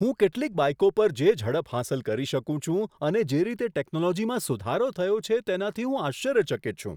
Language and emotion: Gujarati, surprised